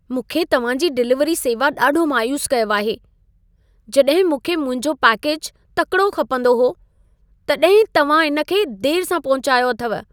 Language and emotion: Sindhi, sad